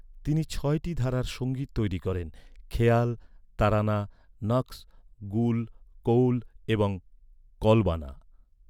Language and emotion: Bengali, neutral